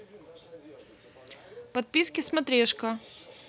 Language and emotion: Russian, neutral